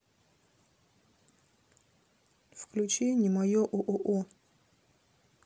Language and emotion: Russian, neutral